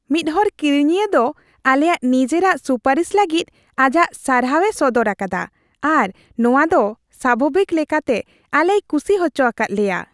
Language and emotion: Santali, happy